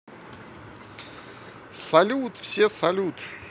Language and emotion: Russian, positive